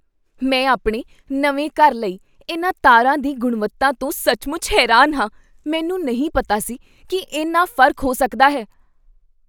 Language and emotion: Punjabi, surprised